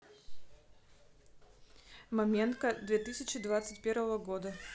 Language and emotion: Russian, neutral